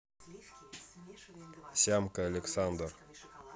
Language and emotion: Russian, neutral